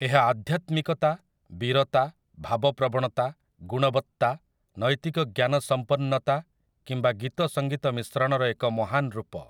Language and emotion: Odia, neutral